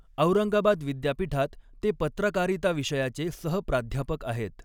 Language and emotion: Marathi, neutral